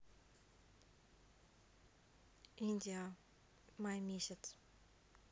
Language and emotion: Russian, neutral